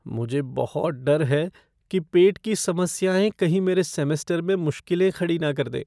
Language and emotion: Hindi, fearful